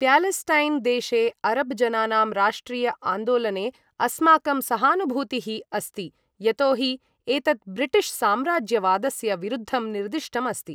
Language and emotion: Sanskrit, neutral